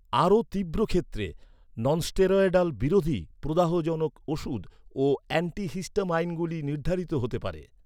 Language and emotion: Bengali, neutral